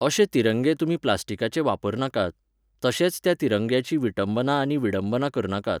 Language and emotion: Goan Konkani, neutral